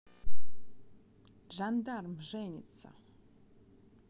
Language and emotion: Russian, neutral